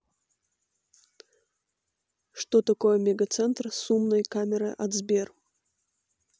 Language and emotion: Russian, neutral